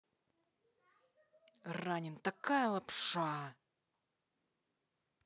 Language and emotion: Russian, angry